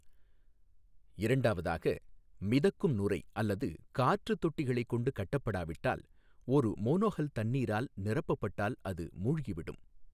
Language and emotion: Tamil, neutral